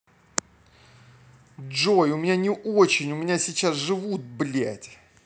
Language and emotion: Russian, angry